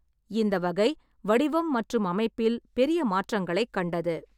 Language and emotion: Tamil, neutral